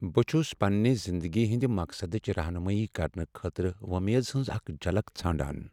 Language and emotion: Kashmiri, sad